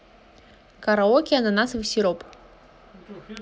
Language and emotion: Russian, positive